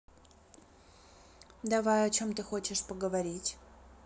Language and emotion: Russian, neutral